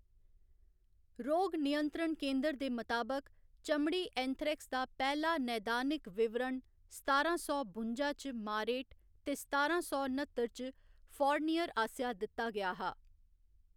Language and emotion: Dogri, neutral